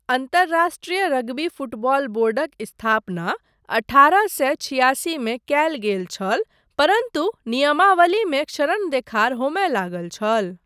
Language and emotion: Maithili, neutral